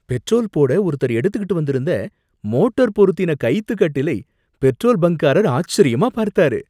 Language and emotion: Tamil, surprised